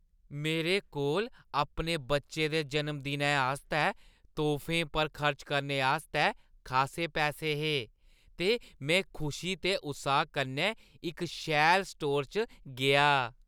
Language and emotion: Dogri, happy